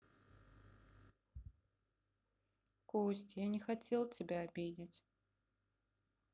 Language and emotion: Russian, sad